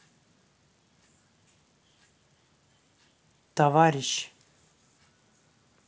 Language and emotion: Russian, neutral